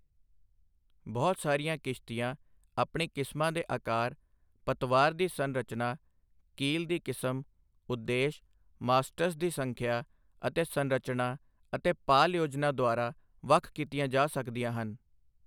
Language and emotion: Punjabi, neutral